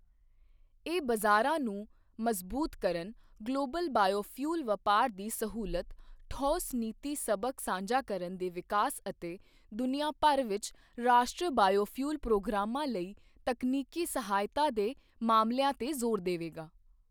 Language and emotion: Punjabi, neutral